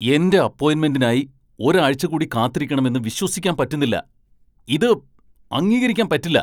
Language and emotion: Malayalam, angry